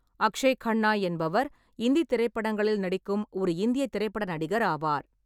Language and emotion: Tamil, neutral